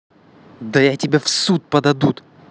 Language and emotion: Russian, angry